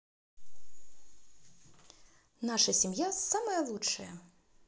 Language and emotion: Russian, positive